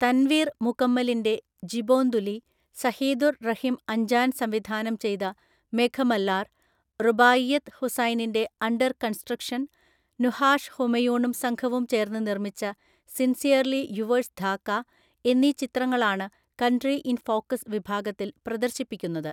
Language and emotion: Malayalam, neutral